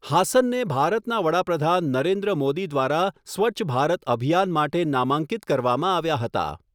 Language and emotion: Gujarati, neutral